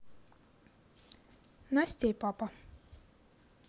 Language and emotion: Russian, neutral